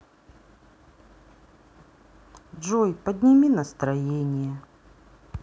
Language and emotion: Russian, sad